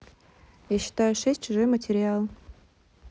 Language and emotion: Russian, neutral